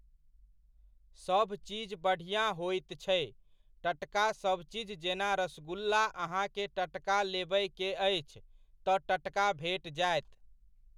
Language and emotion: Maithili, neutral